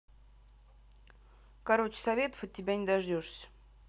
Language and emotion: Russian, angry